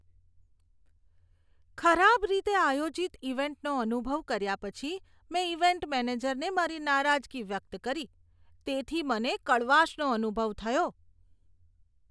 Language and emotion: Gujarati, disgusted